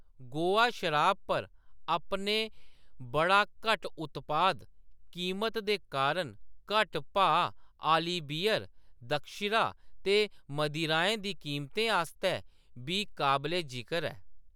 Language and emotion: Dogri, neutral